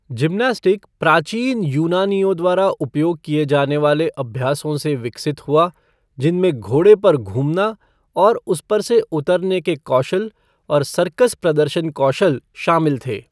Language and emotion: Hindi, neutral